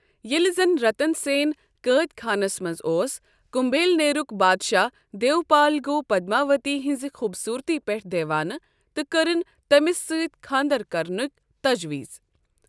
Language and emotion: Kashmiri, neutral